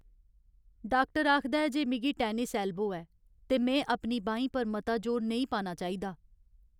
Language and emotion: Dogri, sad